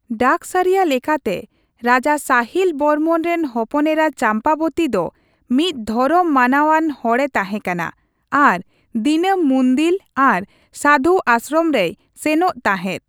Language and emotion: Santali, neutral